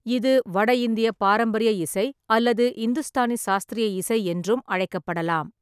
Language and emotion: Tamil, neutral